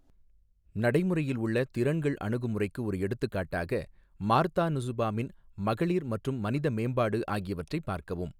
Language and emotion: Tamil, neutral